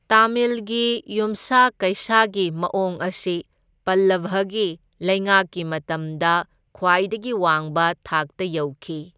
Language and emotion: Manipuri, neutral